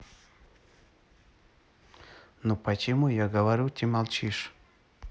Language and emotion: Russian, neutral